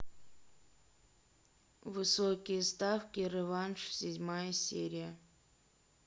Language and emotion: Russian, neutral